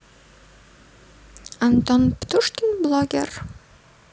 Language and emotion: Russian, neutral